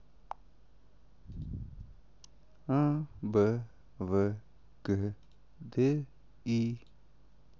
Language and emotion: Russian, sad